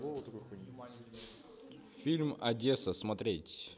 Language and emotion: Russian, neutral